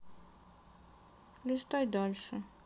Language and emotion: Russian, sad